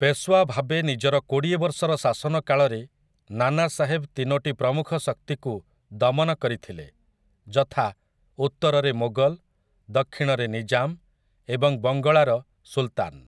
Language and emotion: Odia, neutral